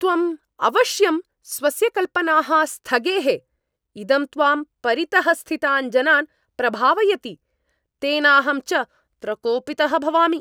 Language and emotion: Sanskrit, angry